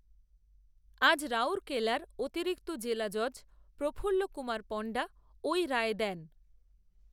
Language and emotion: Bengali, neutral